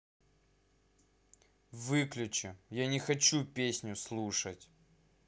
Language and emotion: Russian, angry